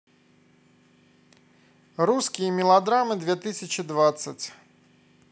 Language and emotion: Russian, neutral